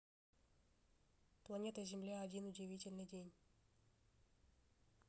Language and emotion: Russian, neutral